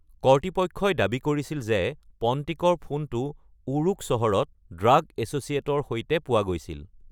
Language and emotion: Assamese, neutral